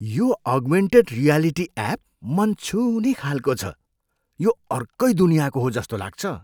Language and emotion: Nepali, surprised